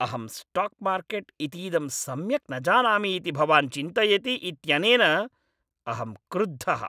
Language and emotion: Sanskrit, angry